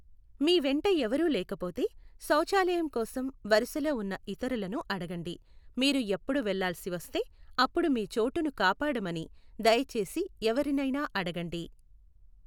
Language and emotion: Telugu, neutral